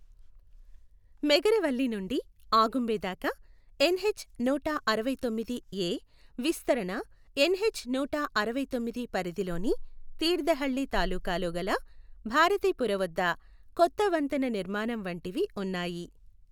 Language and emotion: Telugu, neutral